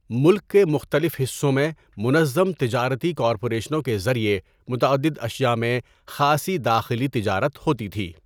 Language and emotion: Urdu, neutral